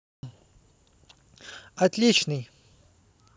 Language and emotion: Russian, positive